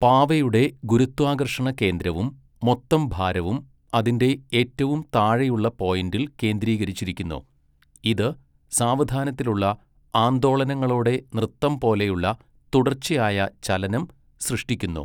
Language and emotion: Malayalam, neutral